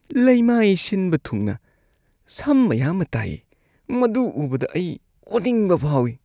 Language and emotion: Manipuri, disgusted